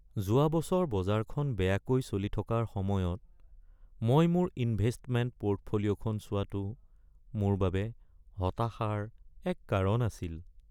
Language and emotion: Assamese, sad